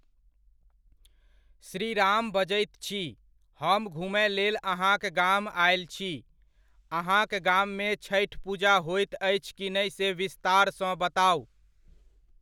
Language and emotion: Maithili, neutral